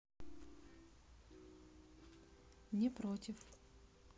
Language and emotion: Russian, neutral